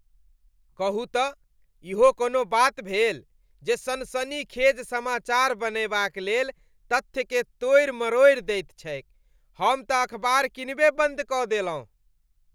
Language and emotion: Maithili, disgusted